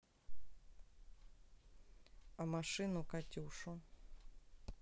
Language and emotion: Russian, neutral